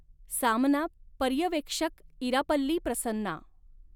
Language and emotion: Marathi, neutral